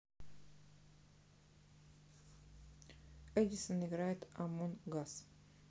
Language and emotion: Russian, neutral